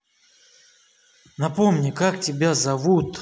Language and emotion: Russian, angry